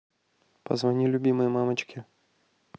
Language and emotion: Russian, neutral